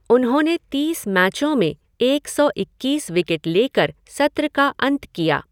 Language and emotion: Hindi, neutral